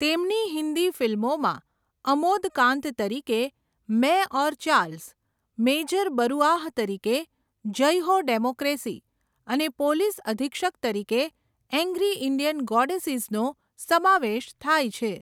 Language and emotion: Gujarati, neutral